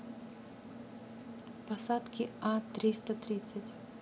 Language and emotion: Russian, neutral